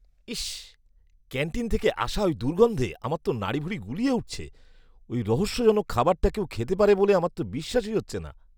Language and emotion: Bengali, disgusted